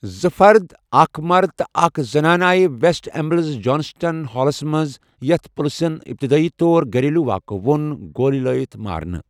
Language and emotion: Kashmiri, neutral